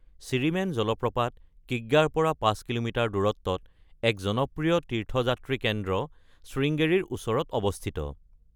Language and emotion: Assamese, neutral